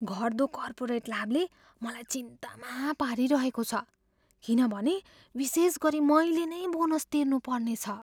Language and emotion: Nepali, fearful